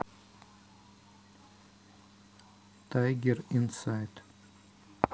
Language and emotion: Russian, neutral